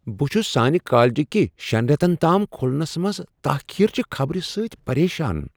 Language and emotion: Kashmiri, surprised